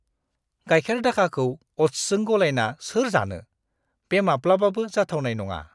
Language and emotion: Bodo, disgusted